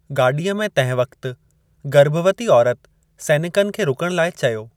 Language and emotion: Sindhi, neutral